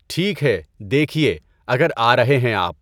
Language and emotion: Urdu, neutral